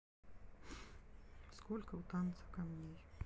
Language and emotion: Russian, neutral